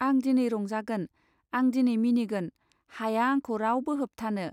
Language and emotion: Bodo, neutral